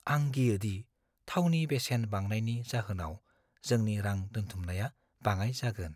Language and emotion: Bodo, fearful